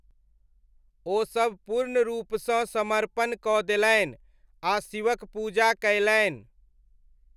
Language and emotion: Maithili, neutral